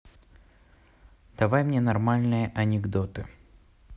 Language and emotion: Russian, neutral